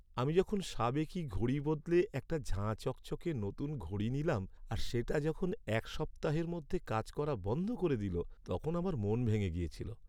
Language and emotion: Bengali, sad